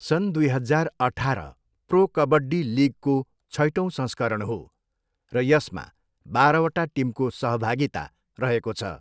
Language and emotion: Nepali, neutral